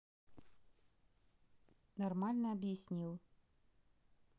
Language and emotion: Russian, neutral